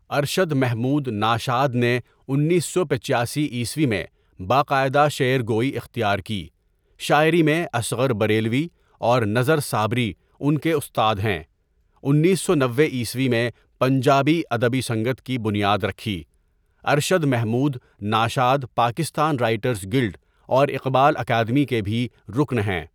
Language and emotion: Urdu, neutral